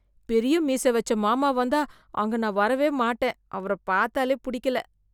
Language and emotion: Tamil, disgusted